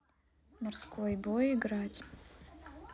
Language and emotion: Russian, neutral